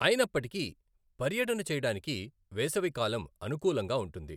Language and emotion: Telugu, neutral